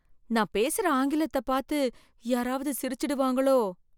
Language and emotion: Tamil, fearful